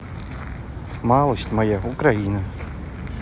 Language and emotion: Russian, neutral